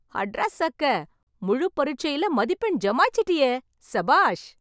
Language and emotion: Tamil, happy